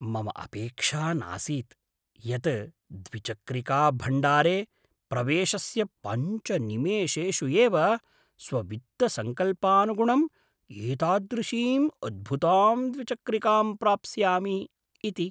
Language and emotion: Sanskrit, surprised